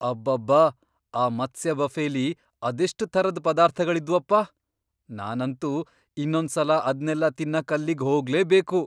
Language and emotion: Kannada, surprised